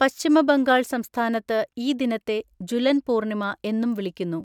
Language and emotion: Malayalam, neutral